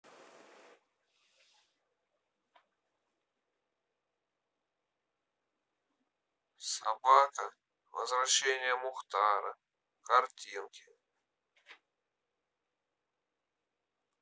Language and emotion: Russian, sad